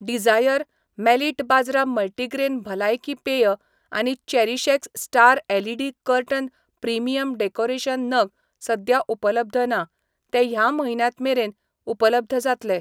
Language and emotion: Goan Konkani, neutral